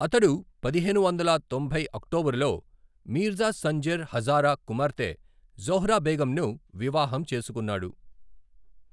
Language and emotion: Telugu, neutral